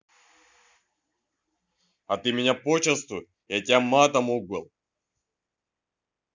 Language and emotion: Russian, angry